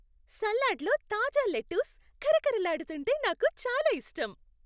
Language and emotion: Telugu, happy